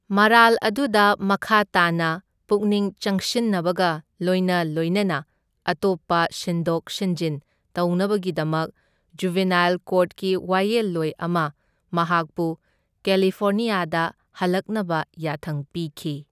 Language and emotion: Manipuri, neutral